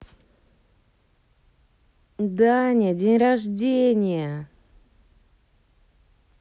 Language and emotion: Russian, positive